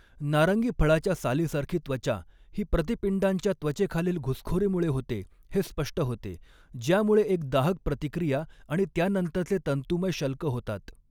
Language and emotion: Marathi, neutral